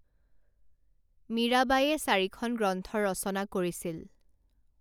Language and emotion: Assamese, neutral